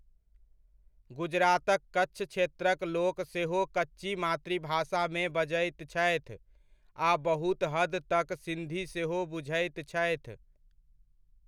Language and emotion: Maithili, neutral